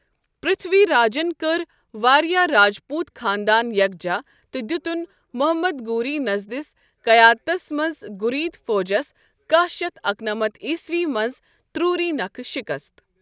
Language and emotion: Kashmiri, neutral